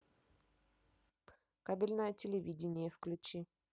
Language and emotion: Russian, neutral